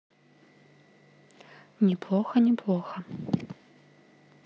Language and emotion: Russian, neutral